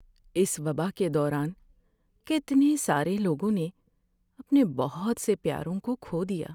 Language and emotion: Urdu, sad